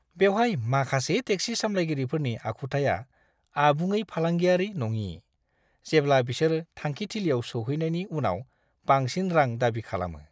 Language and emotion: Bodo, disgusted